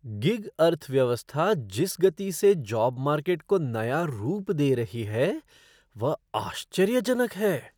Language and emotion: Hindi, surprised